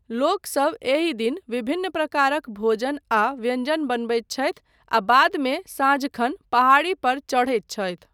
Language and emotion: Maithili, neutral